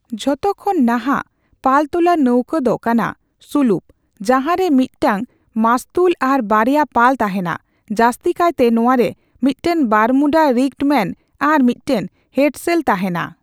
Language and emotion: Santali, neutral